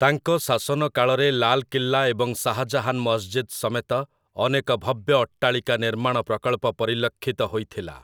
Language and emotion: Odia, neutral